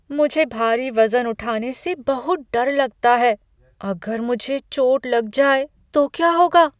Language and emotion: Hindi, fearful